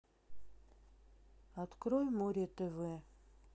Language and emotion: Russian, sad